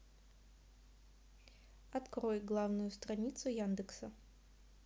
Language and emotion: Russian, neutral